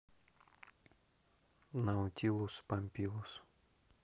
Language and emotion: Russian, neutral